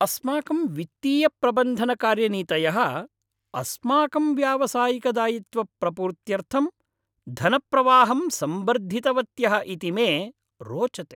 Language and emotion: Sanskrit, happy